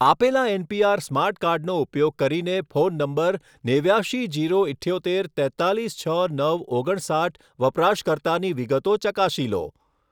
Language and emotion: Gujarati, neutral